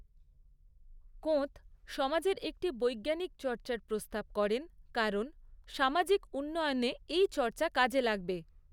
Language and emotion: Bengali, neutral